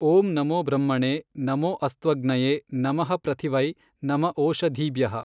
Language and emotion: Kannada, neutral